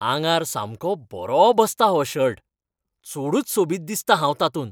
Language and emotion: Goan Konkani, happy